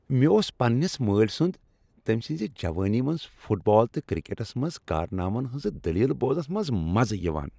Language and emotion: Kashmiri, happy